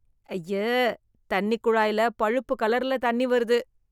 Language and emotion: Tamil, disgusted